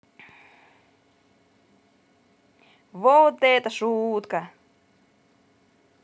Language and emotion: Russian, positive